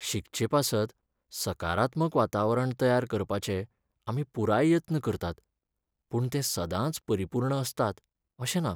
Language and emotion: Goan Konkani, sad